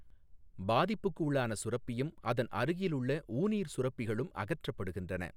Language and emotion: Tamil, neutral